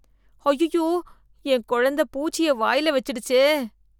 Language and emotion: Tamil, disgusted